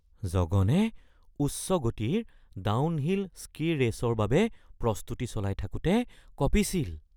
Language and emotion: Assamese, fearful